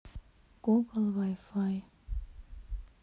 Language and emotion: Russian, sad